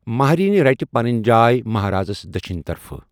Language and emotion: Kashmiri, neutral